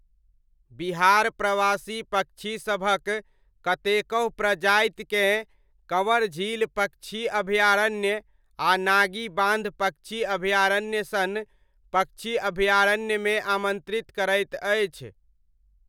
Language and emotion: Maithili, neutral